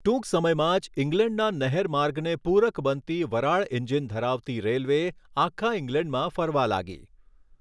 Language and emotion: Gujarati, neutral